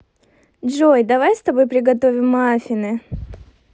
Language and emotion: Russian, positive